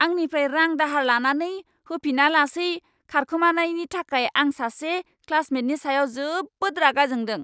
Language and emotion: Bodo, angry